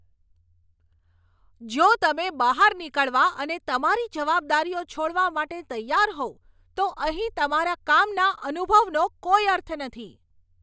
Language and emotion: Gujarati, angry